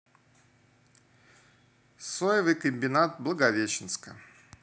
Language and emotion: Russian, neutral